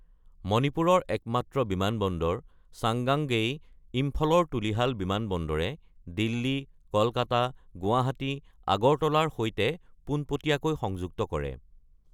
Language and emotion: Assamese, neutral